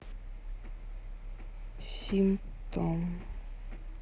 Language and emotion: Russian, sad